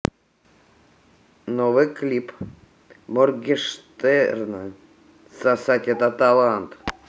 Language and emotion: Russian, neutral